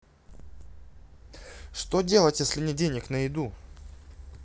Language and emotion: Russian, neutral